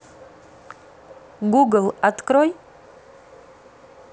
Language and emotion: Russian, neutral